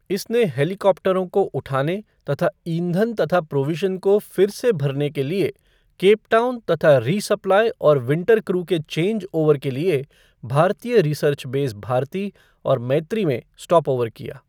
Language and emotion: Hindi, neutral